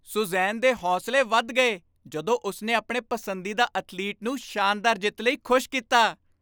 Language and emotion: Punjabi, happy